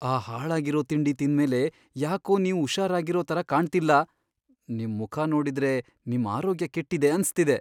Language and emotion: Kannada, fearful